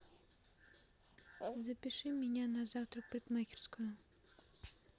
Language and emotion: Russian, neutral